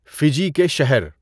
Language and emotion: Urdu, neutral